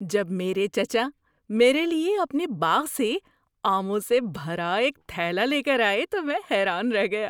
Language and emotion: Urdu, surprised